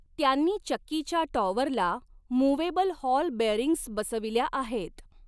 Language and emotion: Marathi, neutral